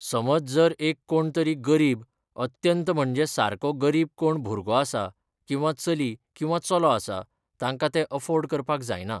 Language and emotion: Goan Konkani, neutral